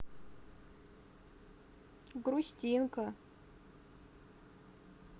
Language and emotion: Russian, sad